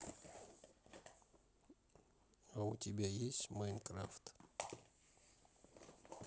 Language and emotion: Russian, neutral